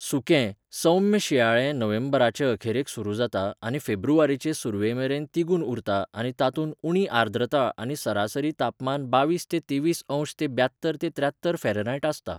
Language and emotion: Goan Konkani, neutral